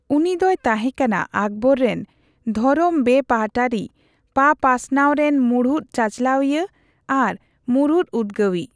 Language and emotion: Santali, neutral